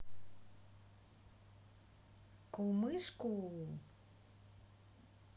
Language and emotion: Russian, positive